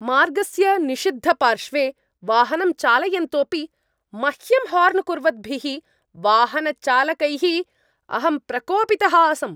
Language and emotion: Sanskrit, angry